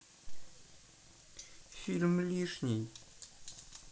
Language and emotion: Russian, neutral